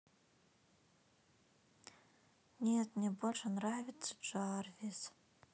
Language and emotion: Russian, sad